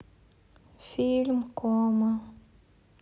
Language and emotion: Russian, sad